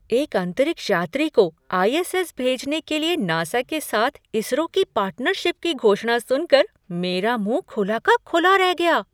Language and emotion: Hindi, surprised